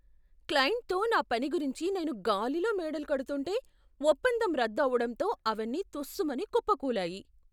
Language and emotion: Telugu, surprised